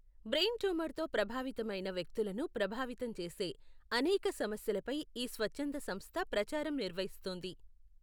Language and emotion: Telugu, neutral